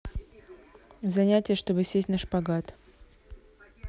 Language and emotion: Russian, neutral